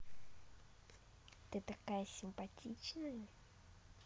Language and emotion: Russian, positive